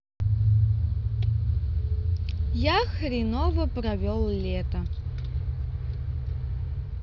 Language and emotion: Russian, neutral